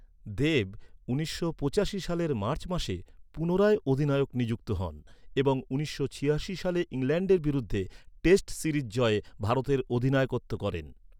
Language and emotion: Bengali, neutral